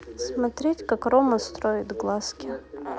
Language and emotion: Russian, neutral